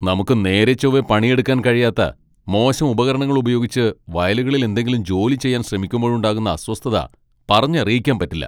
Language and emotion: Malayalam, angry